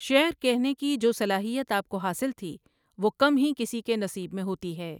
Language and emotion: Urdu, neutral